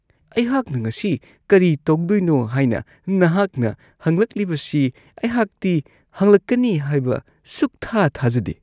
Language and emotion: Manipuri, disgusted